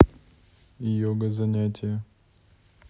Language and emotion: Russian, neutral